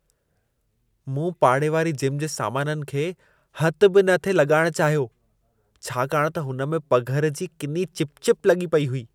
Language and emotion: Sindhi, disgusted